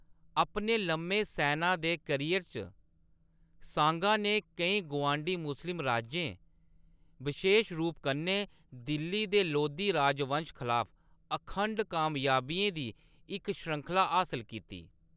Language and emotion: Dogri, neutral